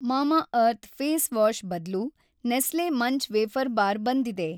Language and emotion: Kannada, neutral